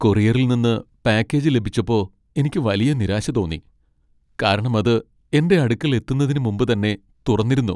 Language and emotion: Malayalam, sad